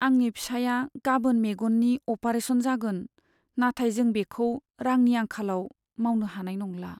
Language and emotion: Bodo, sad